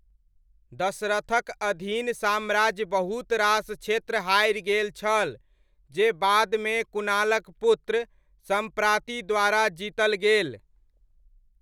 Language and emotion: Maithili, neutral